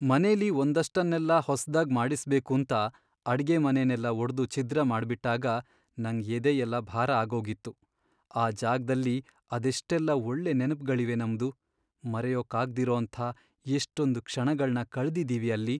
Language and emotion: Kannada, sad